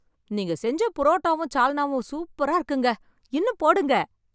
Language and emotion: Tamil, happy